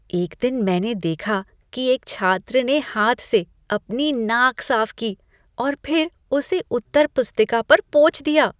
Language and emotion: Hindi, disgusted